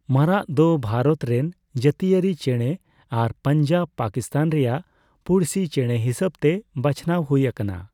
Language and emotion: Santali, neutral